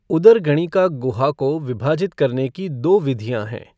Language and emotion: Hindi, neutral